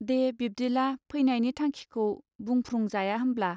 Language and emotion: Bodo, neutral